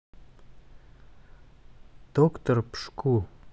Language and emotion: Russian, neutral